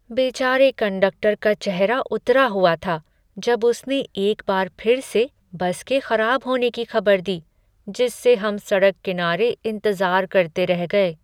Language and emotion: Hindi, sad